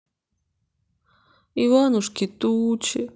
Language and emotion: Russian, sad